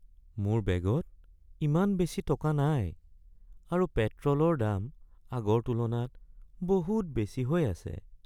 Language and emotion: Assamese, sad